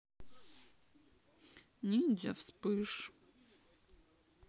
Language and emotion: Russian, sad